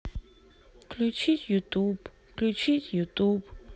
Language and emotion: Russian, sad